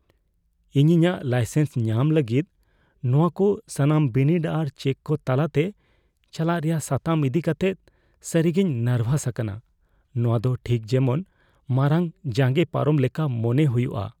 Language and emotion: Santali, fearful